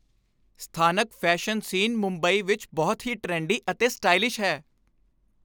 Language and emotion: Punjabi, happy